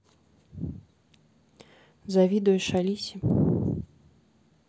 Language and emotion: Russian, neutral